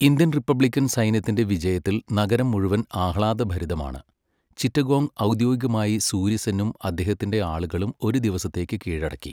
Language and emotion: Malayalam, neutral